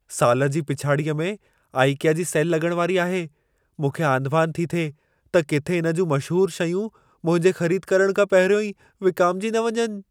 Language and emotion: Sindhi, fearful